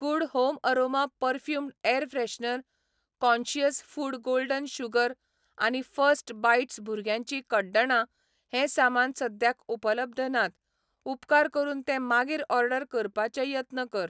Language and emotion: Goan Konkani, neutral